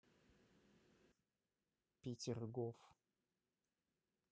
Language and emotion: Russian, neutral